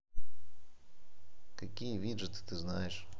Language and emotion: Russian, neutral